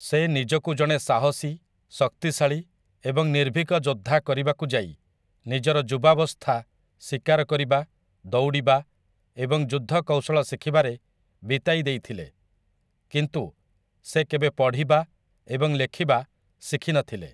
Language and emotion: Odia, neutral